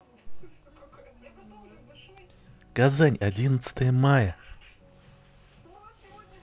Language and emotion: Russian, neutral